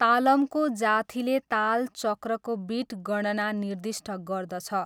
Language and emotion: Nepali, neutral